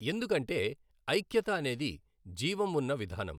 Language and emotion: Telugu, neutral